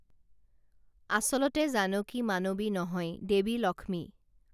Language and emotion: Assamese, neutral